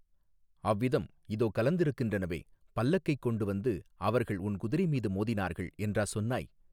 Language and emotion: Tamil, neutral